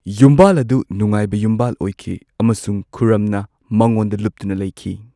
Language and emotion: Manipuri, neutral